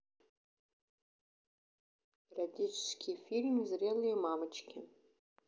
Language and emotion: Russian, neutral